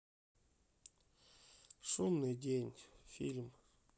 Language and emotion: Russian, sad